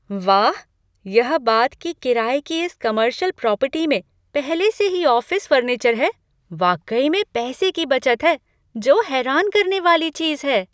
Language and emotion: Hindi, surprised